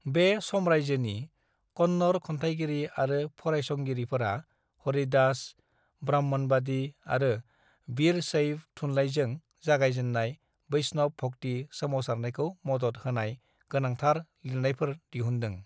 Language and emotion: Bodo, neutral